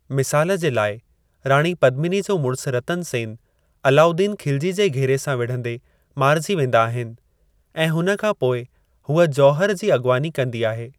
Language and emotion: Sindhi, neutral